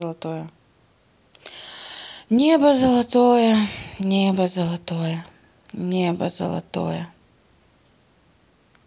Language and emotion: Russian, sad